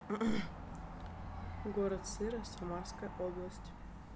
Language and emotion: Russian, neutral